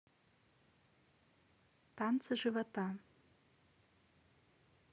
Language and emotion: Russian, neutral